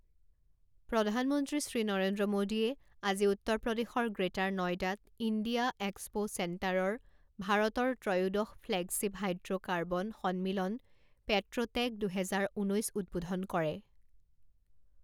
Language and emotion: Assamese, neutral